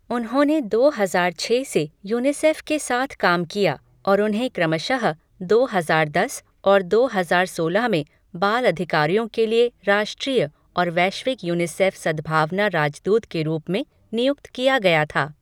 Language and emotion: Hindi, neutral